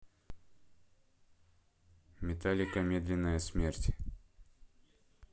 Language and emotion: Russian, neutral